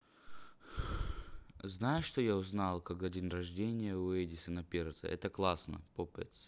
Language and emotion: Russian, neutral